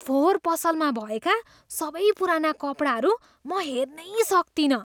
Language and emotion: Nepali, disgusted